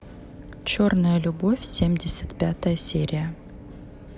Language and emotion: Russian, neutral